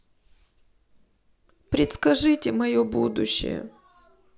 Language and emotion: Russian, sad